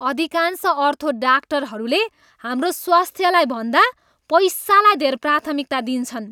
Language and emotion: Nepali, disgusted